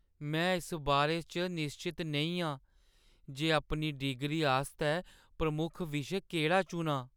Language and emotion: Dogri, sad